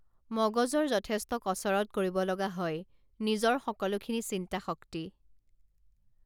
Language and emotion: Assamese, neutral